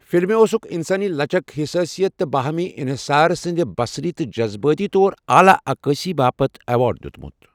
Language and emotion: Kashmiri, neutral